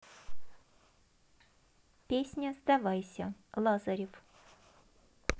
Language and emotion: Russian, neutral